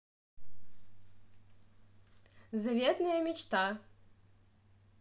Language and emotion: Russian, positive